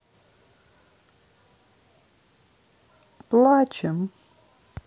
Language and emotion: Russian, sad